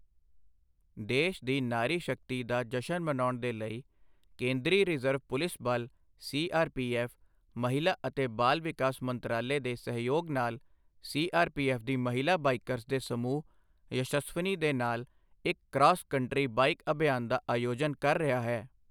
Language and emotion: Punjabi, neutral